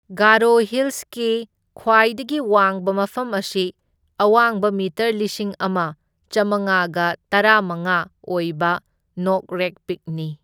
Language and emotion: Manipuri, neutral